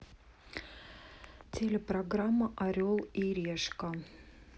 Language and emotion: Russian, neutral